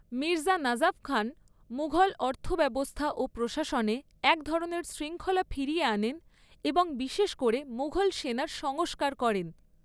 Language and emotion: Bengali, neutral